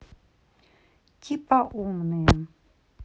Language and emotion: Russian, neutral